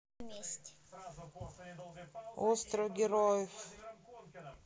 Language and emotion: Russian, neutral